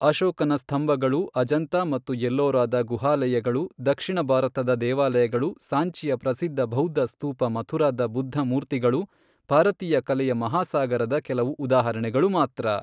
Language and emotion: Kannada, neutral